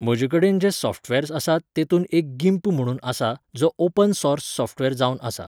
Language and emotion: Goan Konkani, neutral